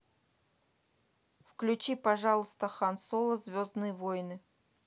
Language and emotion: Russian, neutral